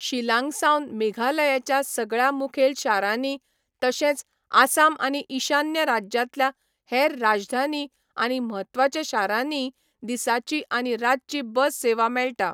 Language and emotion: Goan Konkani, neutral